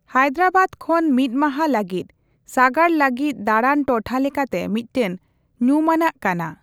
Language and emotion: Santali, neutral